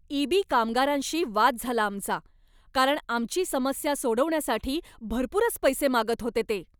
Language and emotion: Marathi, angry